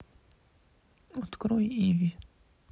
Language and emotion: Russian, sad